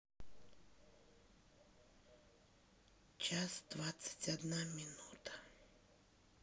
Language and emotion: Russian, neutral